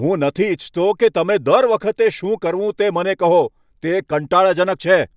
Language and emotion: Gujarati, angry